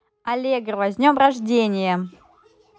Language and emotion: Russian, positive